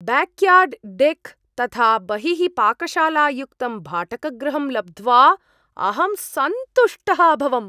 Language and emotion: Sanskrit, surprised